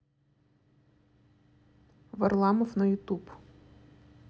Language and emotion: Russian, neutral